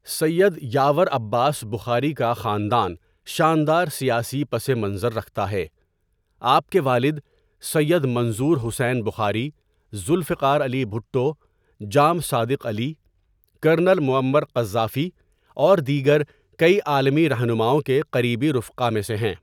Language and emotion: Urdu, neutral